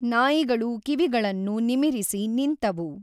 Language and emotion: Kannada, neutral